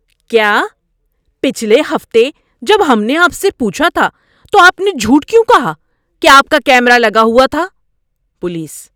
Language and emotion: Urdu, angry